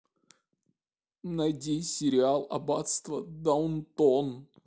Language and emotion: Russian, sad